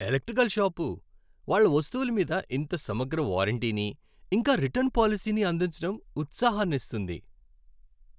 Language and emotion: Telugu, happy